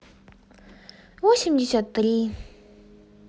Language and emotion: Russian, sad